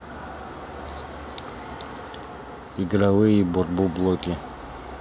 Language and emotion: Russian, neutral